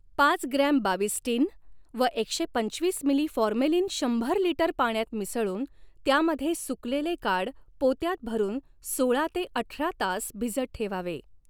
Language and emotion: Marathi, neutral